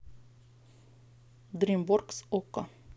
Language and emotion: Russian, neutral